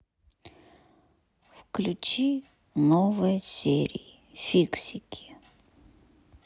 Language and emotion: Russian, sad